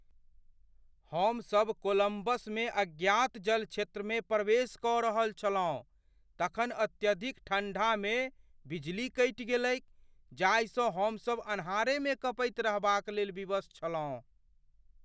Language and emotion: Maithili, fearful